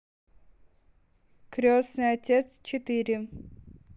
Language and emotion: Russian, neutral